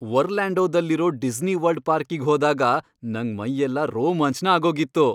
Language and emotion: Kannada, happy